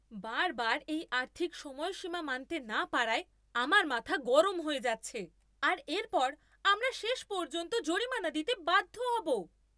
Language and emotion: Bengali, angry